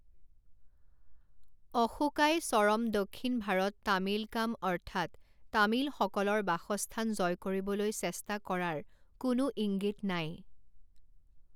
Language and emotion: Assamese, neutral